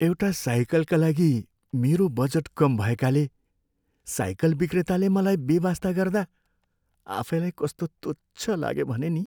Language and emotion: Nepali, sad